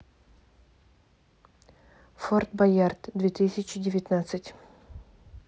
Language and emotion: Russian, neutral